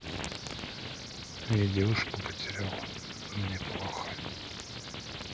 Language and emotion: Russian, sad